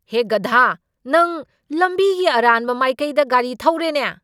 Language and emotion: Manipuri, angry